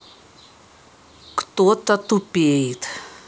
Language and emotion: Russian, angry